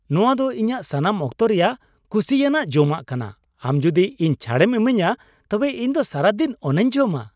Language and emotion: Santali, happy